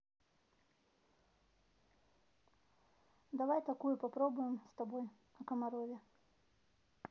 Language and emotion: Russian, neutral